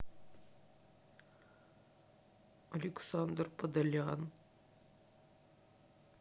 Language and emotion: Russian, sad